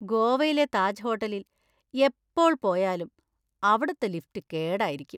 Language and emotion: Malayalam, disgusted